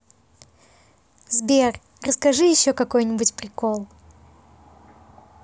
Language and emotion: Russian, positive